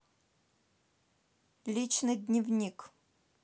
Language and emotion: Russian, neutral